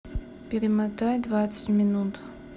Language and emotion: Russian, neutral